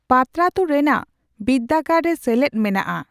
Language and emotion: Santali, neutral